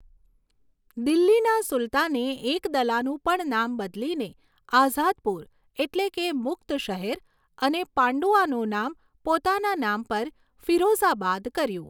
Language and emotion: Gujarati, neutral